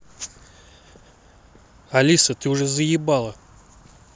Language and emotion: Russian, angry